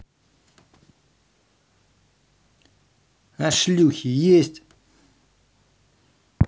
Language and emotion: Russian, angry